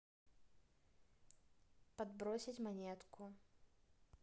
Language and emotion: Russian, neutral